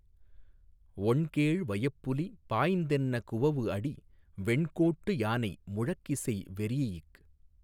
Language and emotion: Tamil, neutral